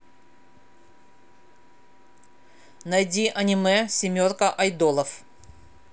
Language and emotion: Russian, angry